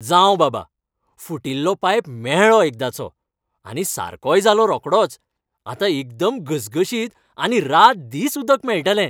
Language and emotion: Goan Konkani, happy